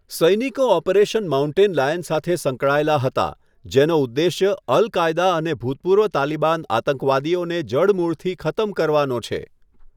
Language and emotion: Gujarati, neutral